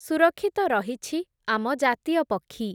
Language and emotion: Odia, neutral